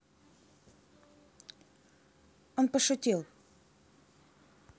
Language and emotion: Russian, neutral